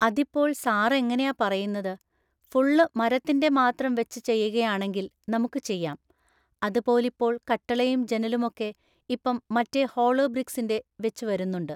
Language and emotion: Malayalam, neutral